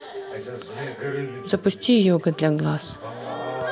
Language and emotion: Russian, neutral